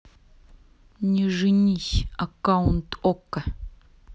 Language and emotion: Russian, neutral